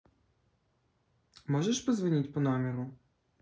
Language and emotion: Russian, neutral